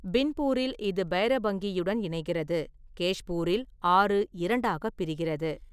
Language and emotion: Tamil, neutral